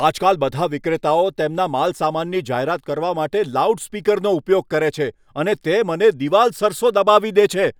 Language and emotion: Gujarati, angry